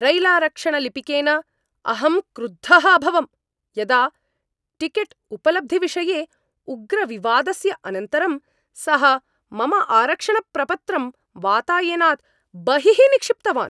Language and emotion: Sanskrit, angry